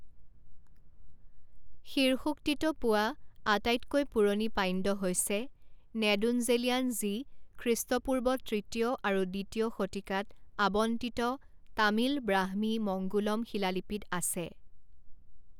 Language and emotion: Assamese, neutral